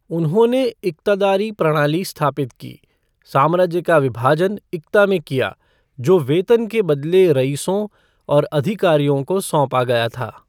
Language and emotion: Hindi, neutral